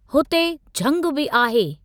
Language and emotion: Sindhi, neutral